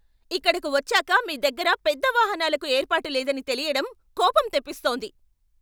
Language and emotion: Telugu, angry